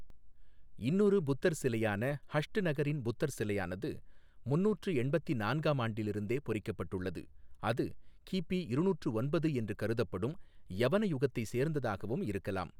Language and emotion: Tamil, neutral